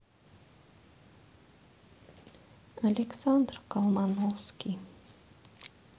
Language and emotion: Russian, sad